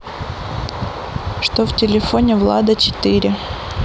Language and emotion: Russian, neutral